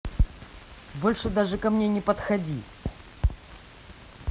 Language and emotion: Russian, angry